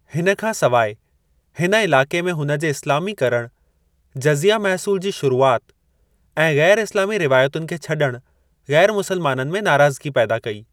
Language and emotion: Sindhi, neutral